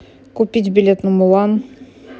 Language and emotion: Russian, neutral